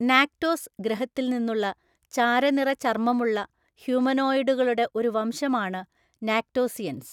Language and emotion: Malayalam, neutral